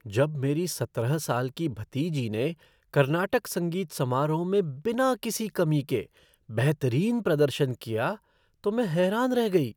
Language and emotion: Hindi, surprised